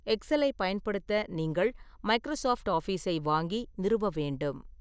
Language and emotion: Tamil, neutral